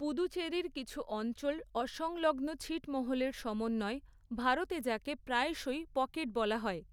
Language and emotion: Bengali, neutral